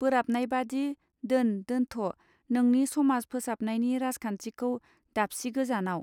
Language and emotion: Bodo, neutral